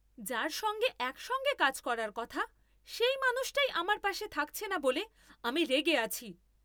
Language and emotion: Bengali, angry